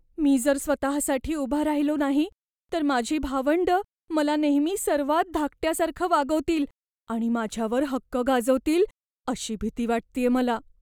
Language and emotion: Marathi, fearful